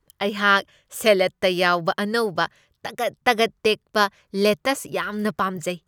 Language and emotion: Manipuri, happy